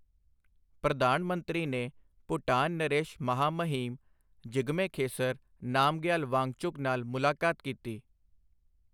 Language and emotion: Punjabi, neutral